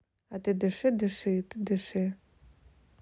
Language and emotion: Russian, neutral